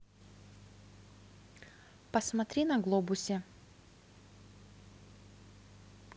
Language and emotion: Russian, neutral